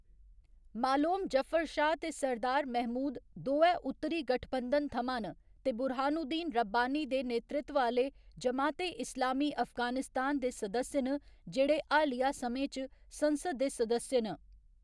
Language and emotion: Dogri, neutral